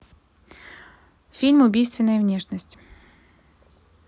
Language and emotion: Russian, neutral